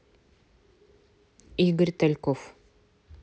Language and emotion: Russian, neutral